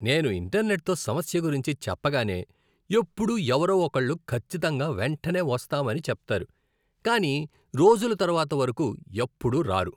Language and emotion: Telugu, disgusted